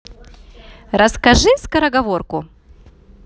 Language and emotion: Russian, positive